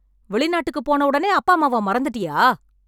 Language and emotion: Tamil, angry